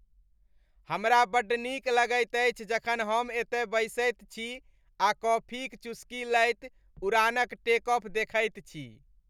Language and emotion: Maithili, happy